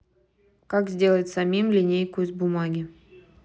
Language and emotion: Russian, neutral